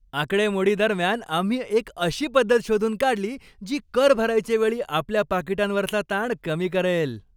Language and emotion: Marathi, happy